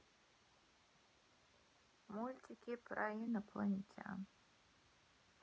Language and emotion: Russian, neutral